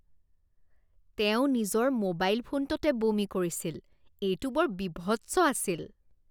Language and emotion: Assamese, disgusted